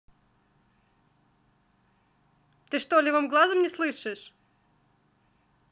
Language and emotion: Russian, angry